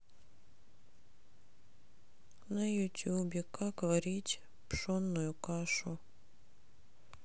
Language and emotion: Russian, sad